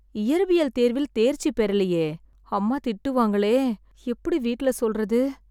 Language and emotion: Tamil, sad